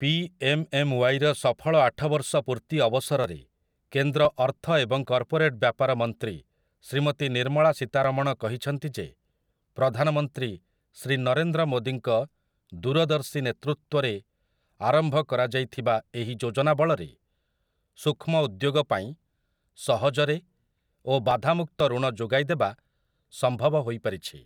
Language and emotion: Odia, neutral